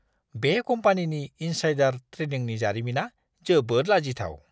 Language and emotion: Bodo, disgusted